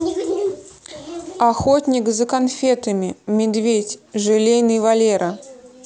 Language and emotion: Russian, neutral